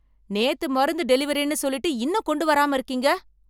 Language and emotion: Tamil, angry